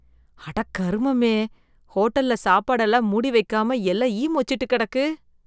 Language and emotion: Tamil, disgusted